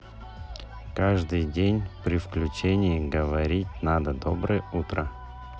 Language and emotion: Russian, neutral